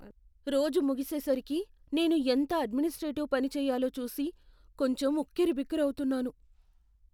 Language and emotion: Telugu, fearful